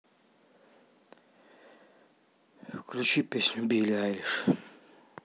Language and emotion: Russian, sad